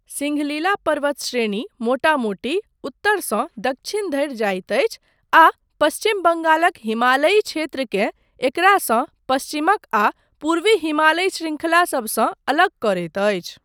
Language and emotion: Maithili, neutral